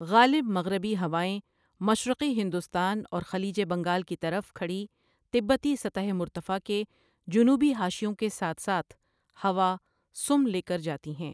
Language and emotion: Urdu, neutral